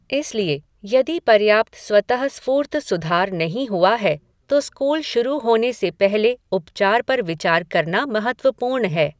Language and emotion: Hindi, neutral